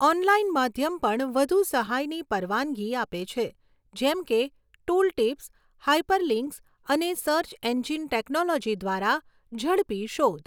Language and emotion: Gujarati, neutral